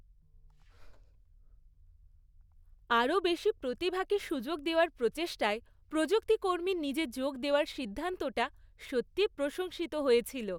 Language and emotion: Bengali, happy